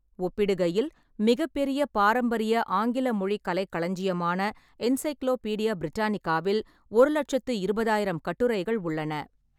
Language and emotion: Tamil, neutral